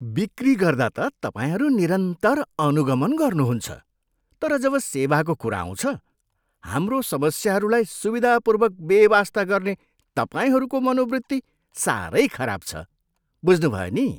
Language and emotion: Nepali, disgusted